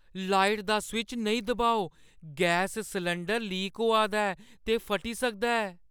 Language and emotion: Dogri, fearful